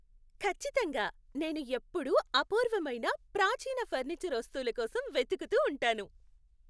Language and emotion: Telugu, happy